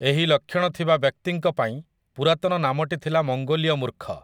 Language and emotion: Odia, neutral